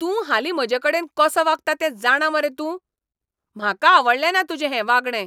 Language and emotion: Goan Konkani, angry